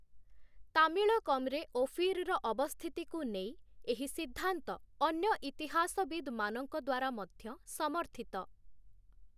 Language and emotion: Odia, neutral